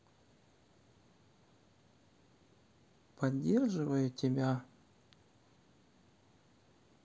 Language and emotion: Russian, neutral